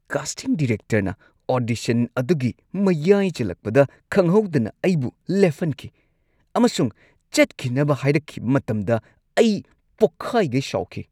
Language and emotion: Manipuri, angry